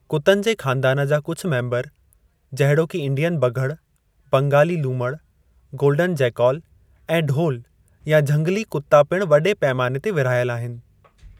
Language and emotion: Sindhi, neutral